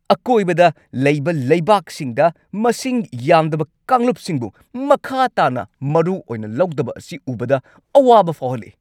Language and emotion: Manipuri, angry